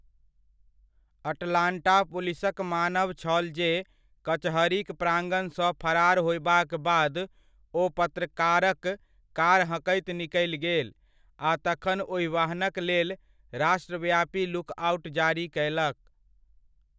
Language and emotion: Maithili, neutral